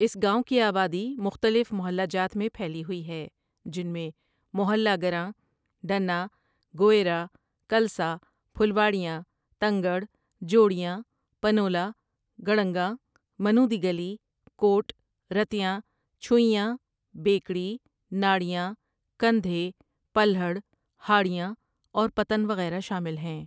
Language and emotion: Urdu, neutral